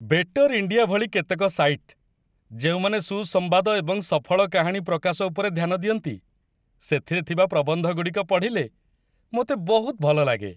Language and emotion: Odia, happy